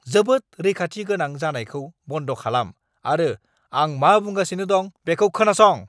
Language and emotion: Bodo, angry